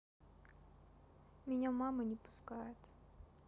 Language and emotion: Russian, sad